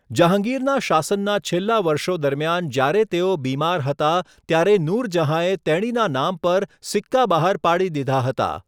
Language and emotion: Gujarati, neutral